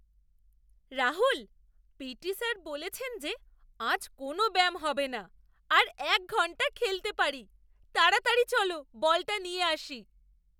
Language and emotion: Bengali, surprised